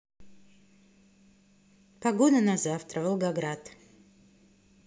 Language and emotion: Russian, neutral